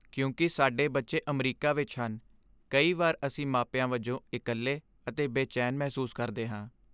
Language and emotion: Punjabi, sad